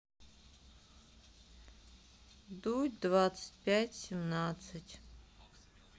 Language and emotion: Russian, sad